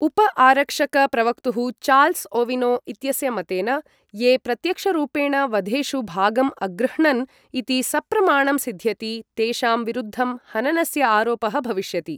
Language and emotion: Sanskrit, neutral